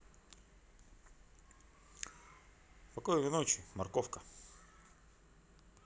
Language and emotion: Russian, neutral